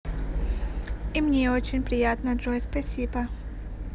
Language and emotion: Russian, positive